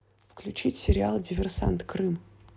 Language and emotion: Russian, neutral